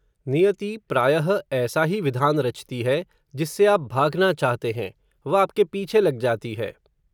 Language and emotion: Hindi, neutral